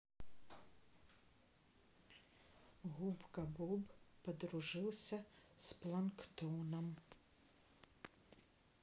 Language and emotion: Russian, neutral